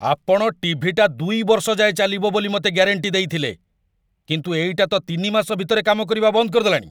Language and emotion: Odia, angry